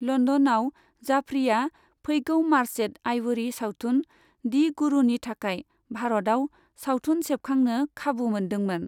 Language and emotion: Bodo, neutral